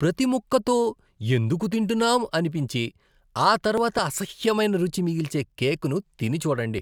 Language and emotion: Telugu, disgusted